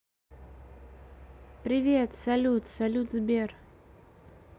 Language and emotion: Russian, neutral